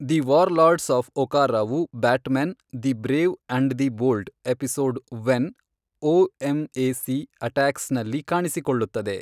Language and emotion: Kannada, neutral